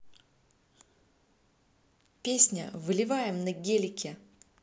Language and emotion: Russian, neutral